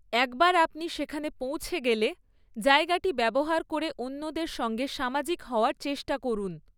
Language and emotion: Bengali, neutral